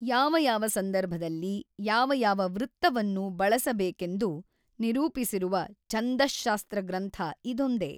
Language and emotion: Kannada, neutral